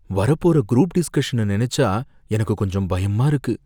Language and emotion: Tamil, fearful